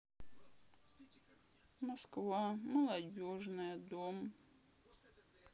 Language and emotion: Russian, sad